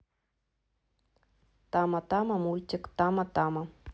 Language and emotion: Russian, neutral